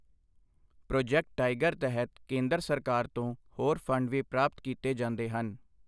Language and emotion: Punjabi, neutral